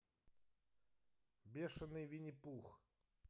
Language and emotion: Russian, neutral